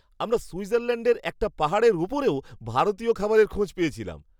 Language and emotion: Bengali, surprised